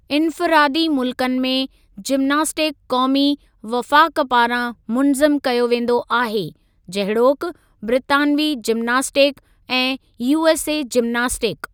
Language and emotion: Sindhi, neutral